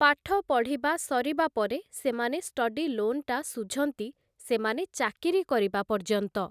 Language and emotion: Odia, neutral